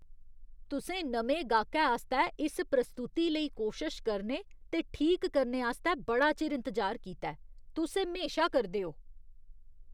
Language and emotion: Dogri, disgusted